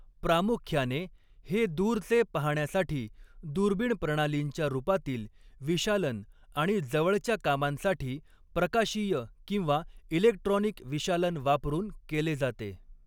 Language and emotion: Marathi, neutral